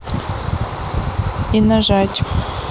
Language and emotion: Russian, neutral